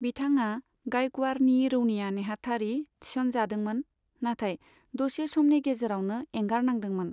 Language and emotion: Bodo, neutral